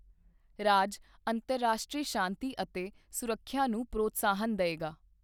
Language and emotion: Punjabi, neutral